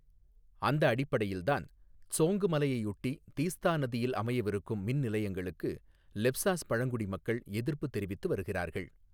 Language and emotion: Tamil, neutral